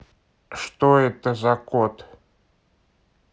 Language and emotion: Russian, neutral